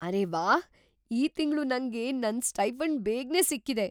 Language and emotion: Kannada, surprised